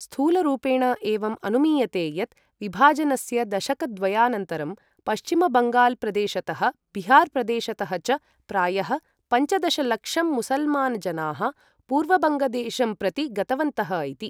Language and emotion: Sanskrit, neutral